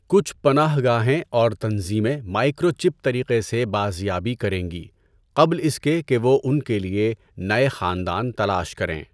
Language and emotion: Urdu, neutral